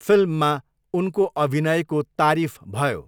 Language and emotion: Nepali, neutral